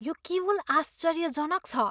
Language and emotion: Nepali, surprised